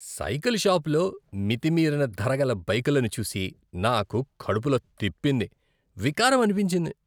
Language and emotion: Telugu, disgusted